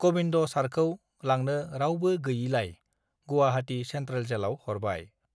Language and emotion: Bodo, neutral